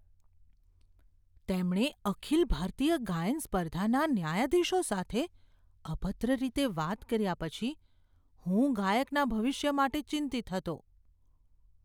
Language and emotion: Gujarati, fearful